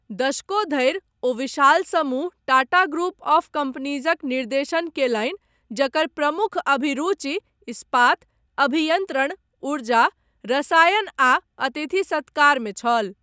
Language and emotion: Maithili, neutral